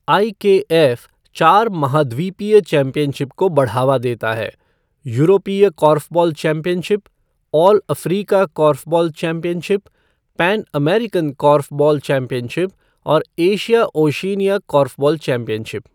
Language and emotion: Hindi, neutral